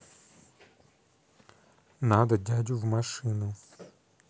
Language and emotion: Russian, neutral